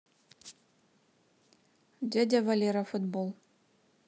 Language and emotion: Russian, neutral